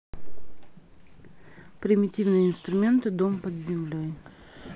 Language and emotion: Russian, neutral